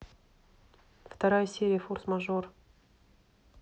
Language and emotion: Russian, neutral